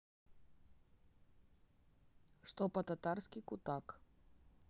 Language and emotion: Russian, neutral